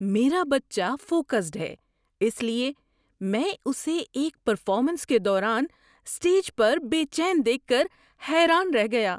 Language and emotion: Urdu, surprised